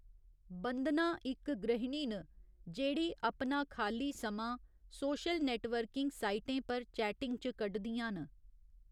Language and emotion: Dogri, neutral